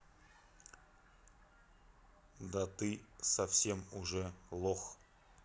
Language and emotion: Russian, neutral